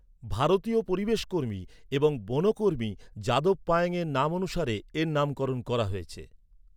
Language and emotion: Bengali, neutral